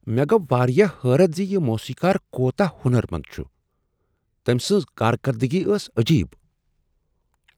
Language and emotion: Kashmiri, surprised